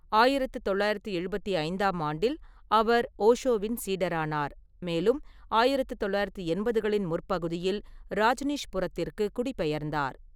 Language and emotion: Tamil, neutral